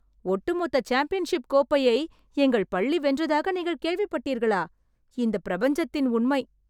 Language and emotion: Tamil, surprised